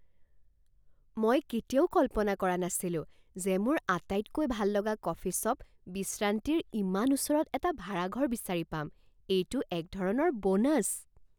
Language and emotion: Assamese, surprised